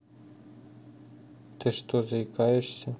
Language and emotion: Russian, neutral